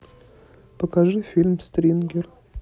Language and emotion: Russian, neutral